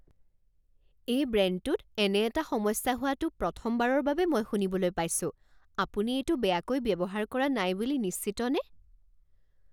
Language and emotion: Assamese, surprised